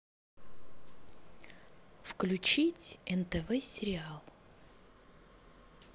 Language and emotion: Russian, neutral